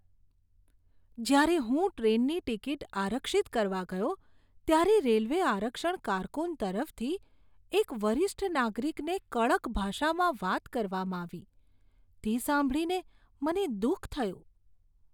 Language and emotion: Gujarati, disgusted